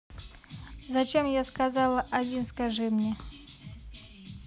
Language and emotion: Russian, neutral